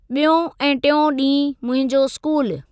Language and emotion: Sindhi, neutral